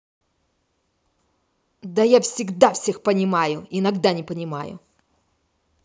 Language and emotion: Russian, angry